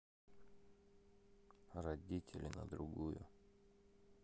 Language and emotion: Russian, sad